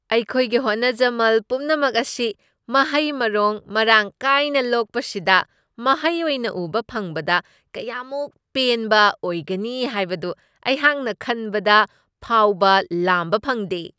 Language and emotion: Manipuri, surprised